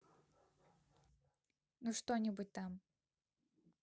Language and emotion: Russian, neutral